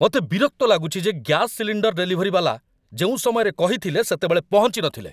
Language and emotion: Odia, angry